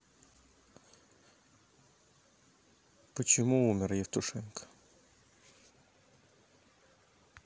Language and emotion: Russian, sad